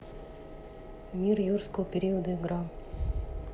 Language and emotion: Russian, neutral